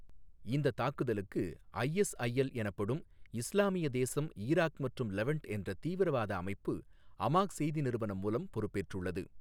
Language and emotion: Tamil, neutral